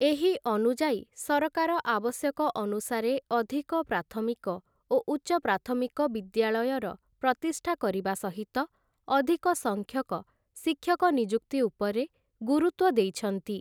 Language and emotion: Odia, neutral